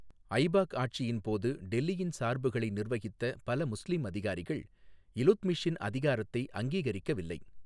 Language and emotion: Tamil, neutral